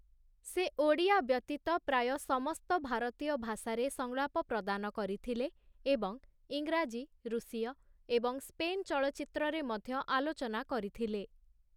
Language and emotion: Odia, neutral